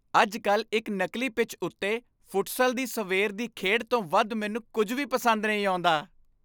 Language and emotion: Punjabi, happy